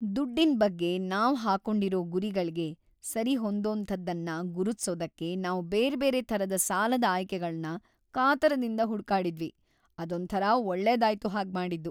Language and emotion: Kannada, happy